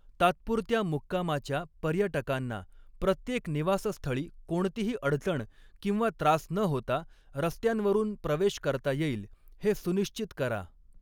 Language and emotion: Marathi, neutral